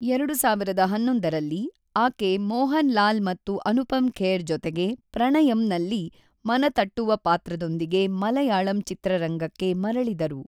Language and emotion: Kannada, neutral